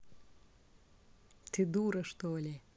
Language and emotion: Russian, neutral